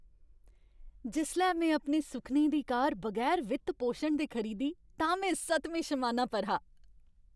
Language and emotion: Dogri, happy